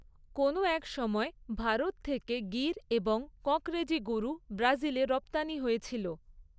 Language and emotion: Bengali, neutral